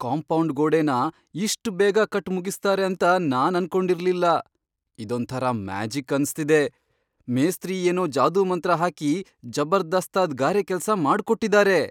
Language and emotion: Kannada, surprised